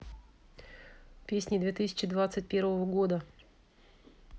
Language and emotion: Russian, neutral